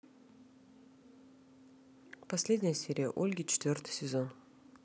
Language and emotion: Russian, neutral